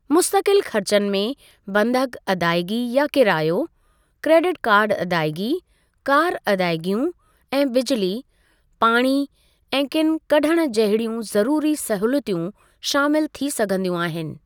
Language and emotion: Sindhi, neutral